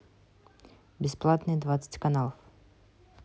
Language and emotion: Russian, neutral